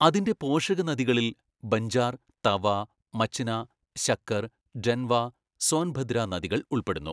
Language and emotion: Malayalam, neutral